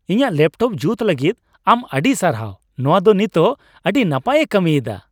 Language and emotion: Santali, happy